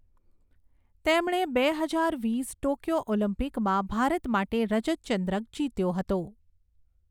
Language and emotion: Gujarati, neutral